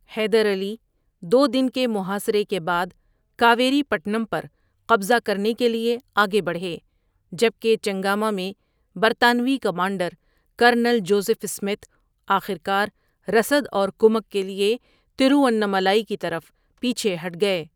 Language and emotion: Urdu, neutral